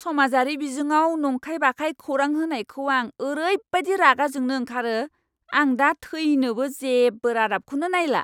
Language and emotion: Bodo, angry